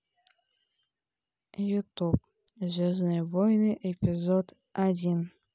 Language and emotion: Russian, neutral